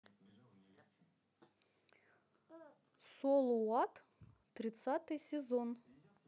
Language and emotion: Russian, neutral